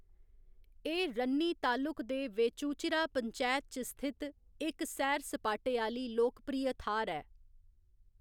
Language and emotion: Dogri, neutral